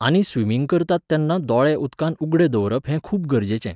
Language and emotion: Goan Konkani, neutral